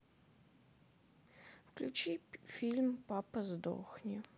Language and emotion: Russian, sad